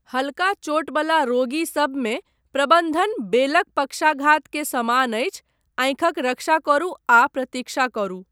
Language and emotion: Maithili, neutral